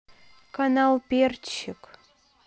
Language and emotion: Russian, neutral